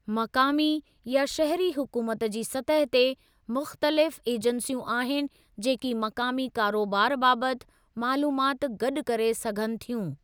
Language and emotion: Sindhi, neutral